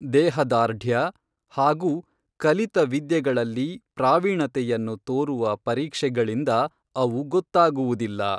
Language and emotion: Kannada, neutral